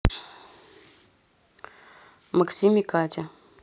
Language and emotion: Russian, neutral